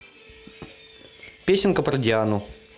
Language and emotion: Russian, neutral